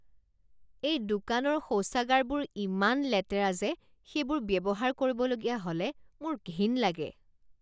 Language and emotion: Assamese, disgusted